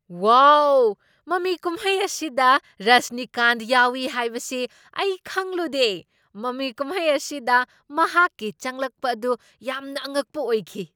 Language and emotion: Manipuri, surprised